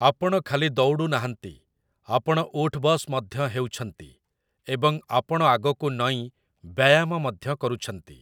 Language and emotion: Odia, neutral